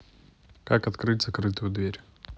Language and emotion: Russian, neutral